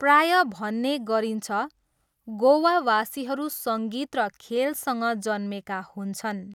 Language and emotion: Nepali, neutral